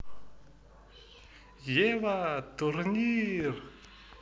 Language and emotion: Russian, positive